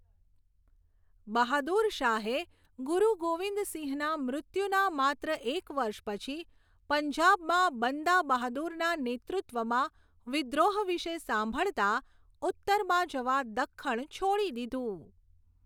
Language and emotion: Gujarati, neutral